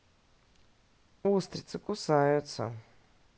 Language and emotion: Russian, neutral